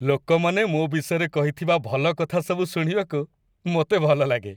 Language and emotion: Odia, happy